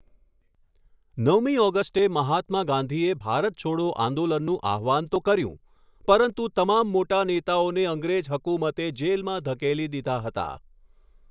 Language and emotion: Gujarati, neutral